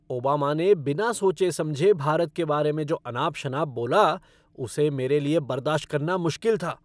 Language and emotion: Hindi, angry